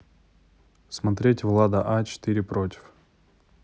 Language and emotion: Russian, neutral